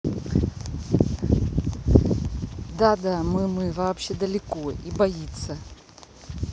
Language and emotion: Russian, neutral